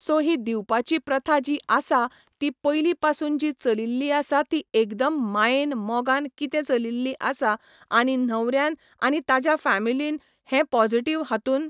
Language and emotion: Goan Konkani, neutral